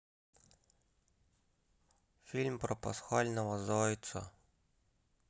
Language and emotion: Russian, sad